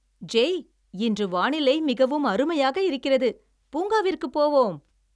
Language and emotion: Tamil, happy